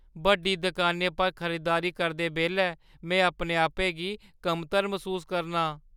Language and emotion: Dogri, fearful